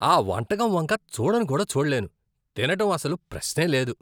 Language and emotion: Telugu, disgusted